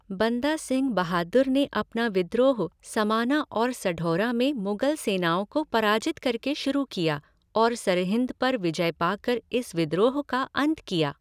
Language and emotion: Hindi, neutral